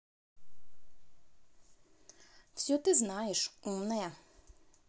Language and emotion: Russian, angry